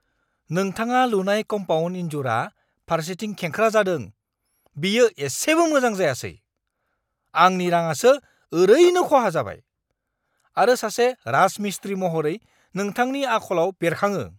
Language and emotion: Bodo, angry